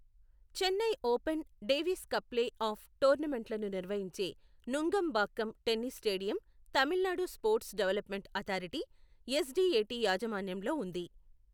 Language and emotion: Telugu, neutral